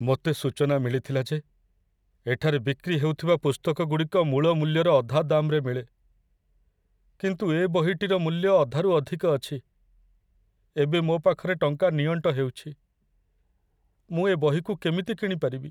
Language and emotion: Odia, sad